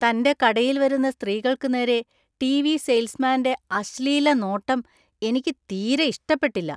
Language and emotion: Malayalam, disgusted